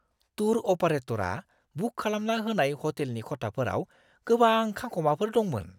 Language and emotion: Bodo, disgusted